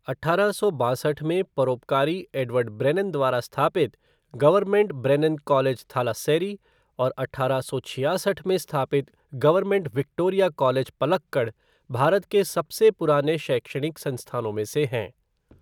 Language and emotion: Hindi, neutral